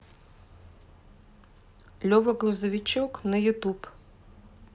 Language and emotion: Russian, neutral